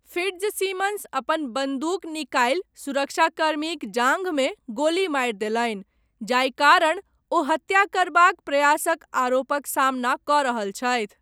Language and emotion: Maithili, neutral